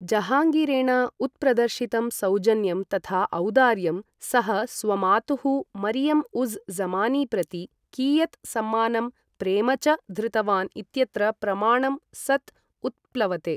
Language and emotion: Sanskrit, neutral